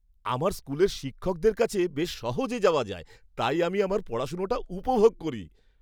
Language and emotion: Bengali, happy